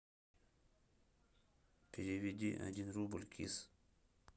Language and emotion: Russian, neutral